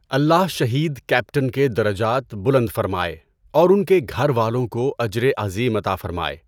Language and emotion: Urdu, neutral